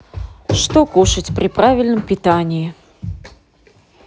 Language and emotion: Russian, neutral